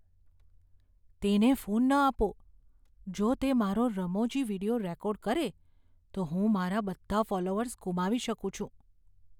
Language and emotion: Gujarati, fearful